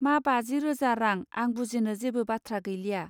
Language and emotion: Bodo, neutral